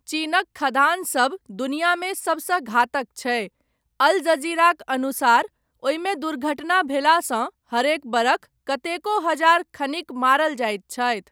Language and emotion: Maithili, neutral